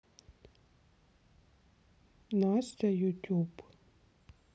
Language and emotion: Russian, sad